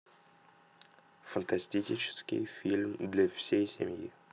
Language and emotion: Russian, neutral